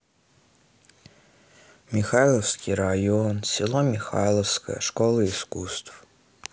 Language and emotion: Russian, sad